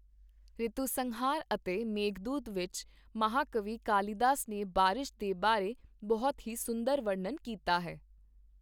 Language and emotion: Punjabi, neutral